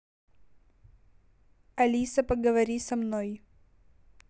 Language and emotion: Russian, neutral